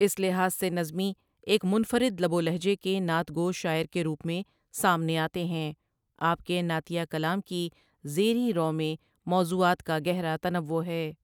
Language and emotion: Urdu, neutral